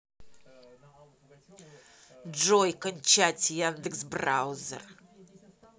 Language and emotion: Russian, angry